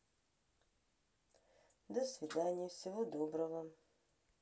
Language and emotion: Russian, positive